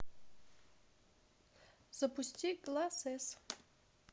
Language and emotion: Russian, neutral